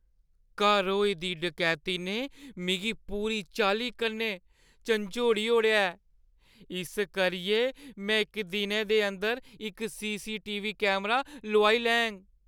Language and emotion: Dogri, fearful